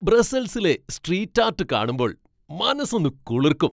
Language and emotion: Malayalam, happy